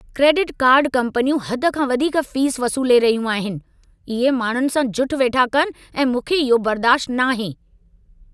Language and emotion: Sindhi, angry